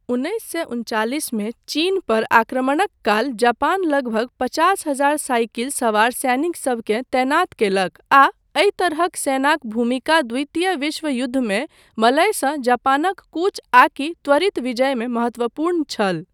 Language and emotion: Maithili, neutral